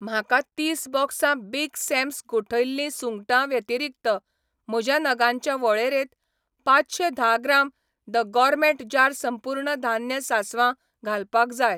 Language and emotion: Goan Konkani, neutral